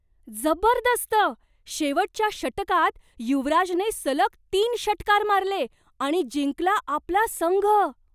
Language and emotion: Marathi, surprised